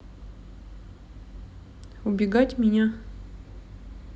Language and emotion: Russian, neutral